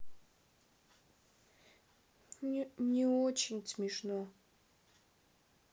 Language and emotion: Russian, sad